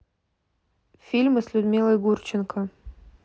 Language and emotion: Russian, neutral